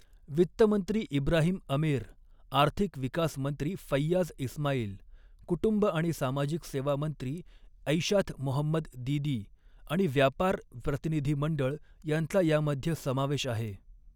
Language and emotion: Marathi, neutral